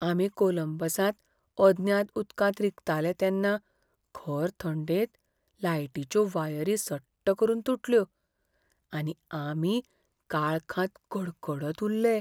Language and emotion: Goan Konkani, fearful